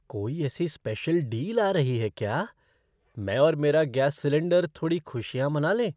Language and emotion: Hindi, surprised